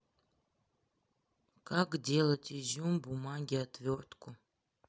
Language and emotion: Russian, sad